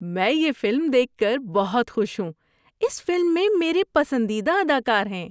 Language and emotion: Urdu, happy